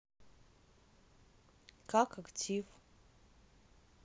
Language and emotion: Russian, neutral